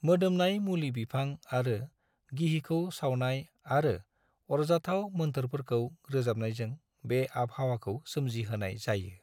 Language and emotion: Bodo, neutral